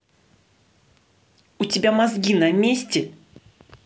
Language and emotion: Russian, angry